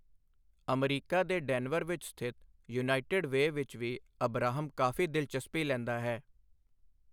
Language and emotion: Punjabi, neutral